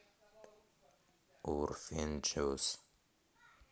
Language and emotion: Russian, neutral